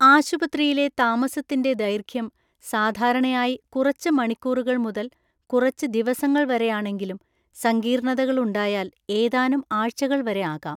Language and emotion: Malayalam, neutral